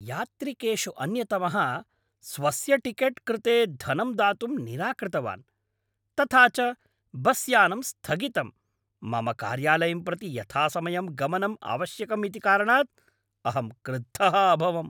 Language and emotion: Sanskrit, angry